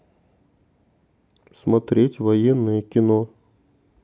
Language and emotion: Russian, neutral